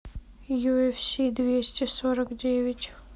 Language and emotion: Russian, sad